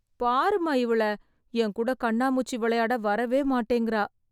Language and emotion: Tamil, sad